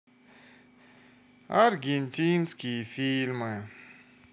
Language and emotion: Russian, sad